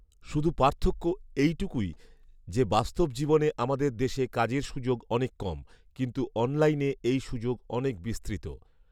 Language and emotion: Bengali, neutral